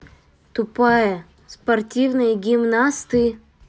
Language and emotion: Russian, neutral